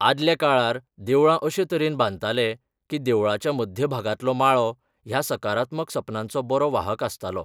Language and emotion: Goan Konkani, neutral